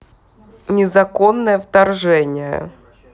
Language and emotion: Russian, neutral